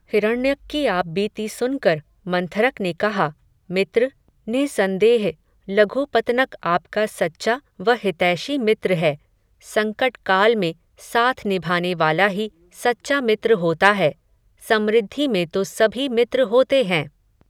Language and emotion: Hindi, neutral